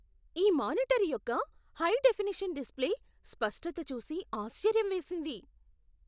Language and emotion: Telugu, surprised